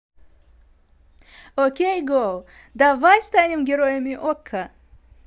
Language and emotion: Russian, positive